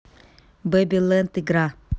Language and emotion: Russian, neutral